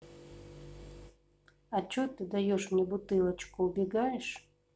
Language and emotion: Russian, neutral